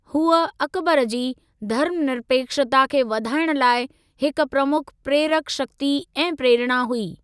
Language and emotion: Sindhi, neutral